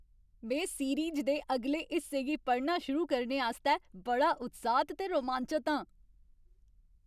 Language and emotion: Dogri, happy